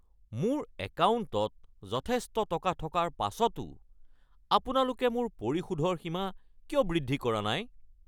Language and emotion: Assamese, angry